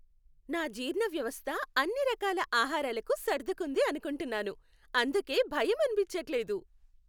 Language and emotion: Telugu, happy